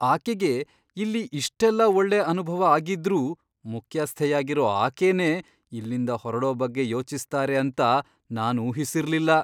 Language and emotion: Kannada, surprised